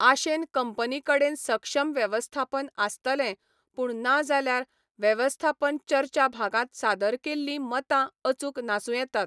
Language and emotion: Goan Konkani, neutral